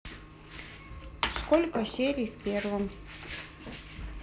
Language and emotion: Russian, neutral